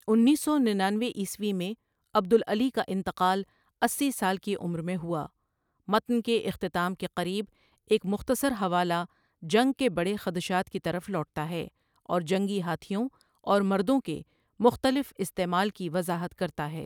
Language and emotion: Urdu, neutral